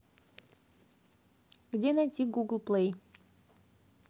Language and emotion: Russian, positive